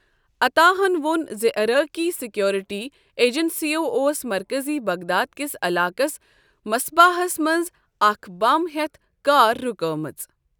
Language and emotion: Kashmiri, neutral